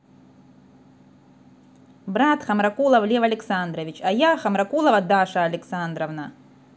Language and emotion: Russian, angry